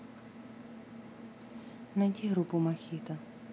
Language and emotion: Russian, neutral